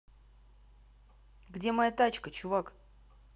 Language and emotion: Russian, neutral